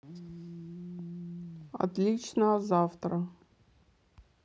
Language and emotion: Russian, neutral